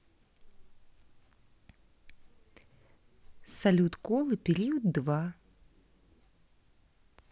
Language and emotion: Russian, neutral